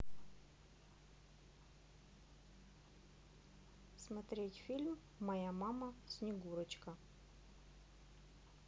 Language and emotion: Russian, neutral